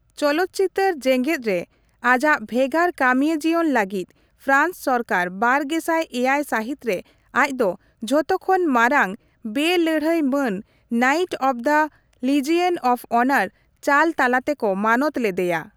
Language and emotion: Santali, neutral